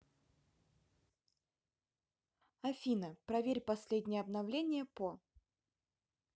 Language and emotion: Russian, neutral